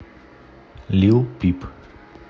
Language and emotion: Russian, neutral